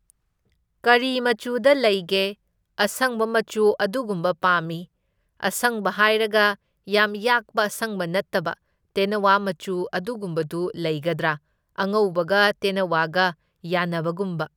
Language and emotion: Manipuri, neutral